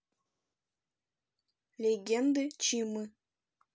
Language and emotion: Russian, neutral